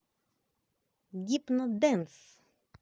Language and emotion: Russian, positive